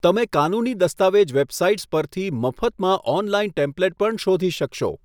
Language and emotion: Gujarati, neutral